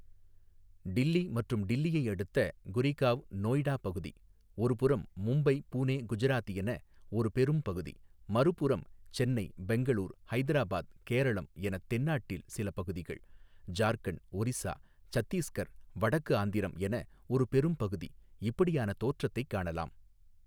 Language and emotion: Tamil, neutral